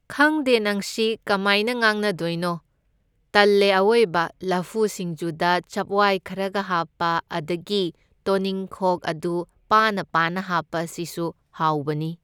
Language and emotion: Manipuri, neutral